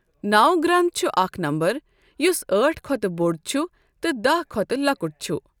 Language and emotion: Kashmiri, neutral